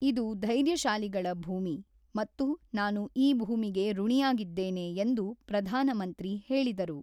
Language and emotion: Kannada, neutral